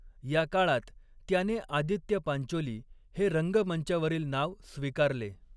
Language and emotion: Marathi, neutral